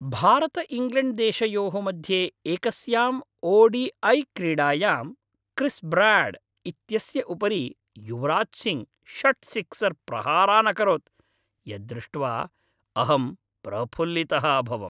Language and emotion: Sanskrit, happy